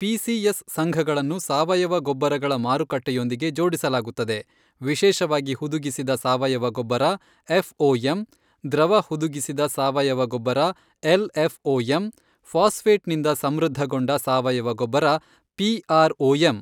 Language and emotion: Kannada, neutral